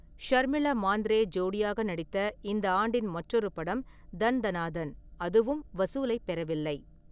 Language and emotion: Tamil, neutral